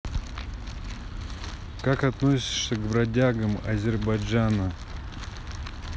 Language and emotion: Russian, neutral